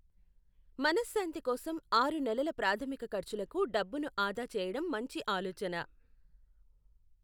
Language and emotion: Telugu, neutral